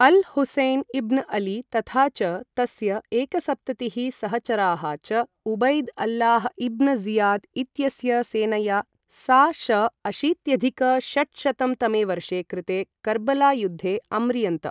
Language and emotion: Sanskrit, neutral